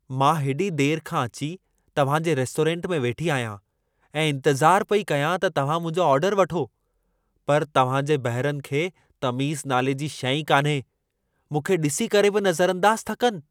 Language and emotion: Sindhi, angry